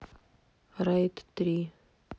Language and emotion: Russian, sad